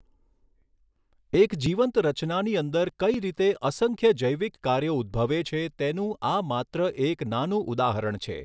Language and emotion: Gujarati, neutral